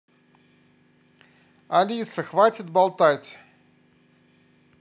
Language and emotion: Russian, angry